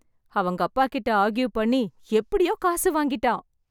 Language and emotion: Tamil, happy